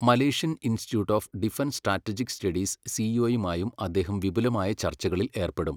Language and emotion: Malayalam, neutral